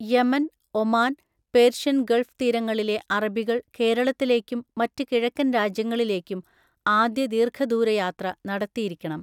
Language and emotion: Malayalam, neutral